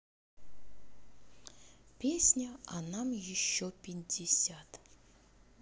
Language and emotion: Russian, neutral